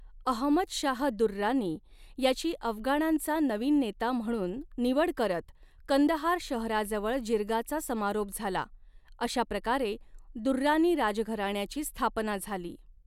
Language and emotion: Marathi, neutral